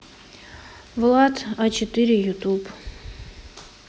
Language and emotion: Russian, neutral